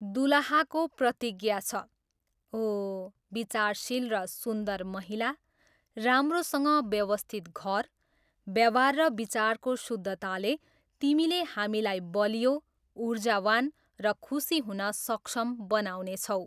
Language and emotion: Nepali, neutral